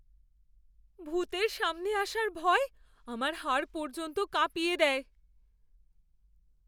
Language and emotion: Bengali, fearful